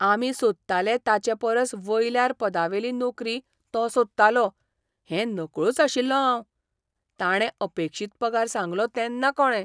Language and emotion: Goan Konkani, surprised